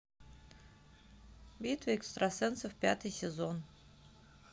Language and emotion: Russian, neutral